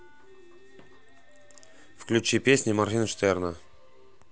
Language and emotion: Russian, neutral